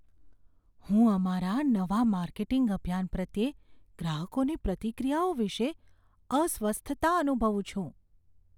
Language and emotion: Gujarati, fearful